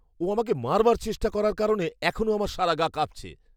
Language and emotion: Bengali, fearful